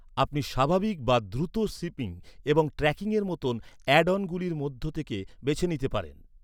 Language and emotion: Bengali, neutral